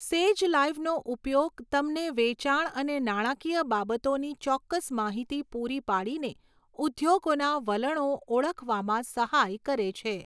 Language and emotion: Gujarati, neutral